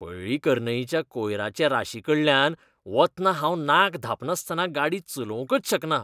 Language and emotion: Goan Konkani, disgusted